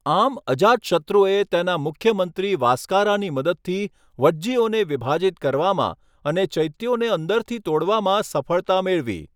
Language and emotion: Gujarati, neutral